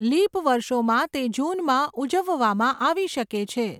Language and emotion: Gujarati, neutral